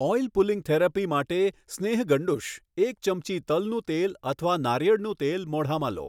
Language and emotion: Gujarati, neutral